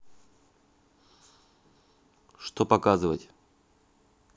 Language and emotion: Russian, neutral